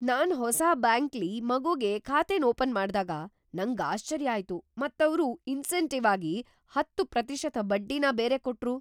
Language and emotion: Kannada, surprised